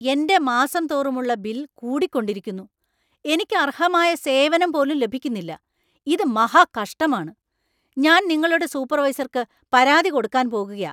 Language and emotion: Malayalam, angry